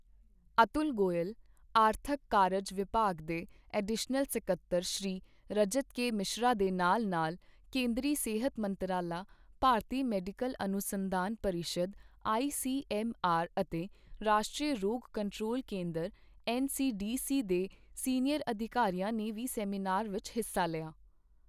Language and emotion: Punjabi, neutral